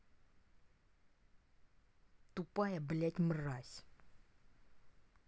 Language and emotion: Russian, angry